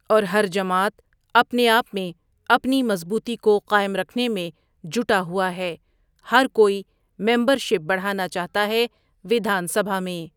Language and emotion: Urdu, neutral